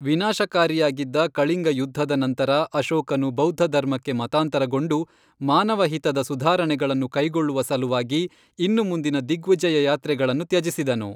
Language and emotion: Kannada, neutral